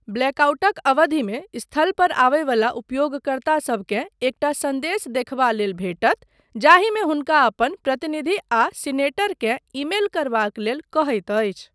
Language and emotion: Maithili, neutral